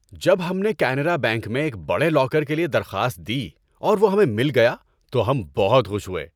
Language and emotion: Urdu, happy